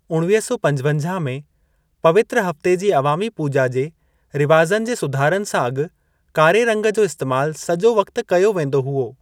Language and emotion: Sindhi, neutral